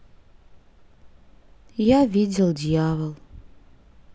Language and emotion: Russian, sad